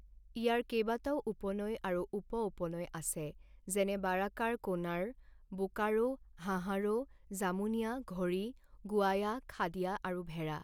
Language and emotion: Assamese, neutral